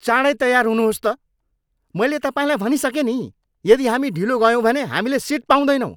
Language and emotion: Nepali, angry